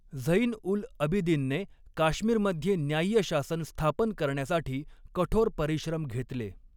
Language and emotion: Marathi, neutral